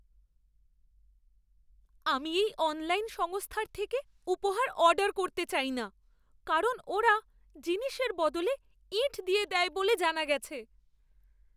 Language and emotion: Bengali, fearful